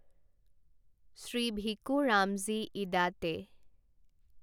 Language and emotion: Assamese, neutral